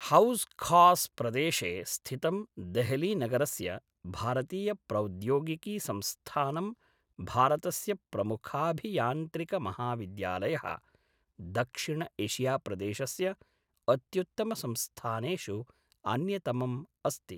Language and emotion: Sanskrit, neutral